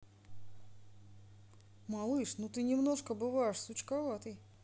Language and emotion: Russian, positive